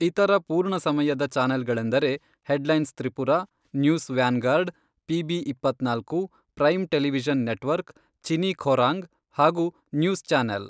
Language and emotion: Kannada, neutral